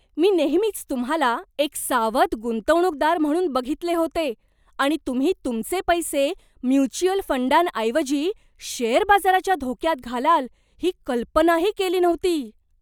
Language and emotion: Marathi, surprised